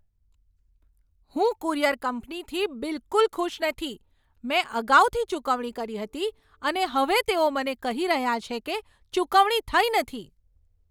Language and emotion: Gujarati, angry